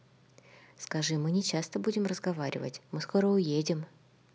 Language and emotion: Russian, neutral